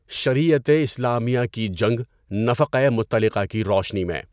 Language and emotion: Urdu, neutral